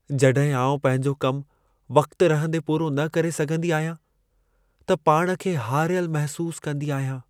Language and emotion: Sindhi, sad